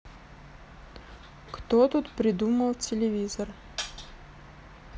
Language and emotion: Russian, neutral